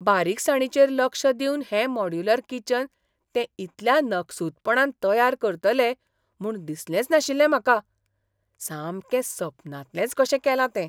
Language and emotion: Goan Konkani, surprised